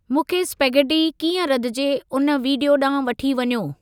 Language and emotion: Sindhi, neutral